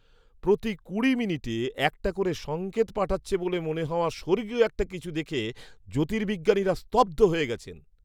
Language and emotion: Bengali, surprised